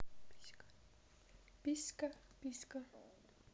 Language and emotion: Russian, neutral